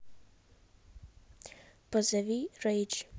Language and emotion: Russian, neutral